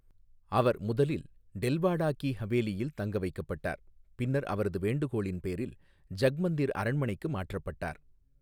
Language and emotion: Tamil, neutral